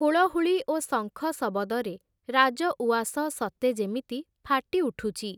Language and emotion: Odia, neutral